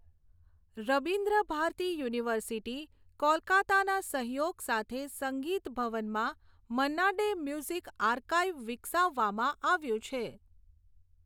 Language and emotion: Gujarati, neutral